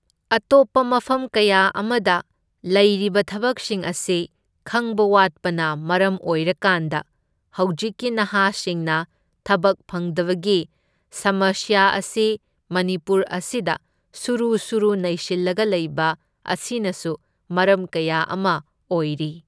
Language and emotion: Manipuri, neutral